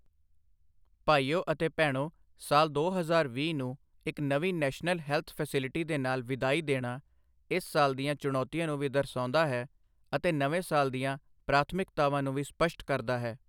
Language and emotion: Punjabi, neutral